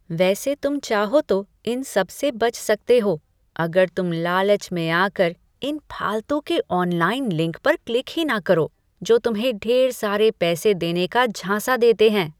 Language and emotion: Hindi, disgusted